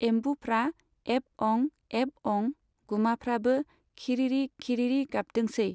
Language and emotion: Bodo, neutral